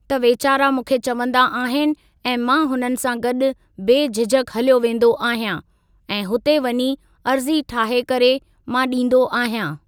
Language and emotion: Sindhi, neutral